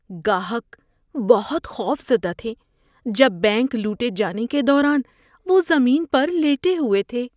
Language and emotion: Urdu, fearful